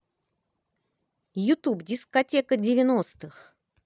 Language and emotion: Russian, positive